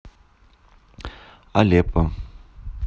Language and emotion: Russian, neutral